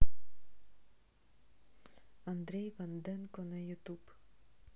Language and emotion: Russian, neutral